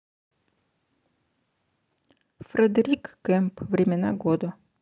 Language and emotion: Russian, neutral